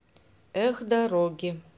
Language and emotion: Russian, neutral